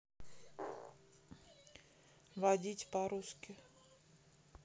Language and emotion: Russian, neutral